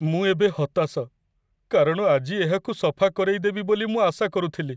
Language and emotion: Odia, sad